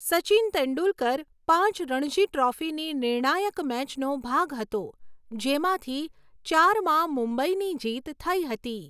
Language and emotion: Gujarati, neutral